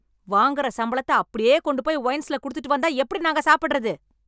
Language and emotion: Tamil, angry